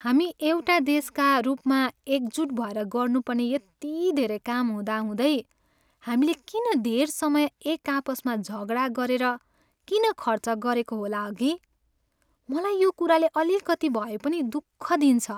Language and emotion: Nepali, sad